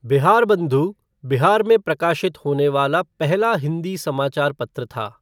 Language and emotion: Hindi, neutral